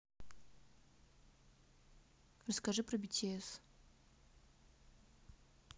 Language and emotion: Russian, neutral